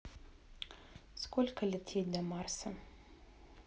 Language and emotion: Russian, neutral